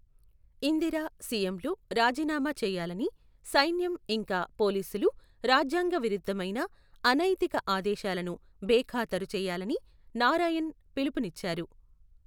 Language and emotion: Telugu, neutral